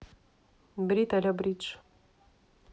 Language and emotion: Russian, neutral